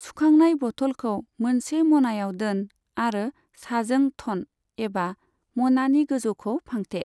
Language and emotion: Bodo, neutral